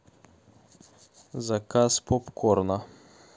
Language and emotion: Russian, neutral